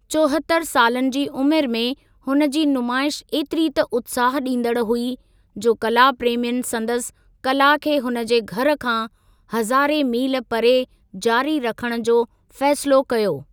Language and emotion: Sindhi, neutral